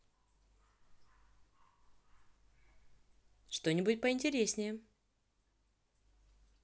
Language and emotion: Russian, positive